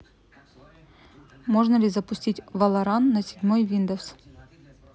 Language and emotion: Russian, neutral